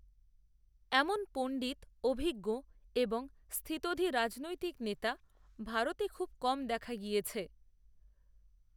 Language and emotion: Bengali, neutral